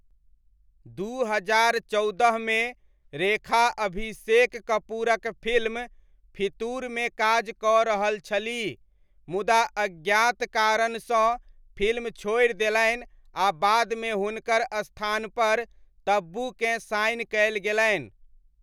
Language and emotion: Maithili, neutral